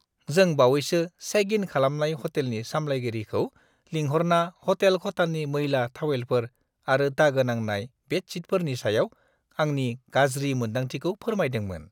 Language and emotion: Bodo, disgusted